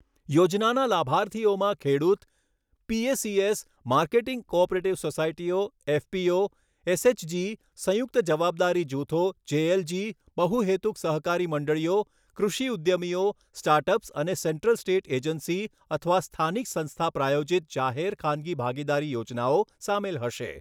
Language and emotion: Gujarati, neutral